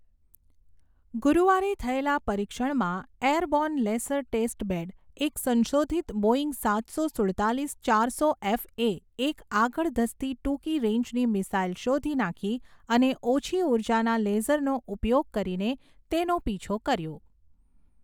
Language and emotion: Gujarati, neutral